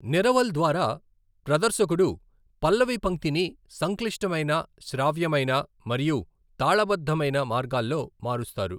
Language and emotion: Telugu, neutral